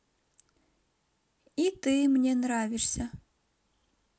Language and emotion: Russian, positive